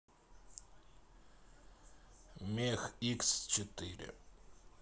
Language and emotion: Russian, neutral